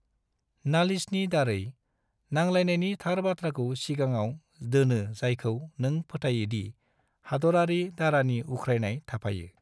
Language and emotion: Bodo, neutral